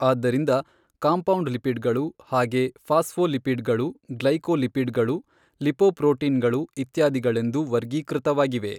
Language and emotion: Kannada, neutral